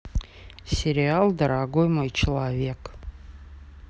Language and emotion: Russian, neutral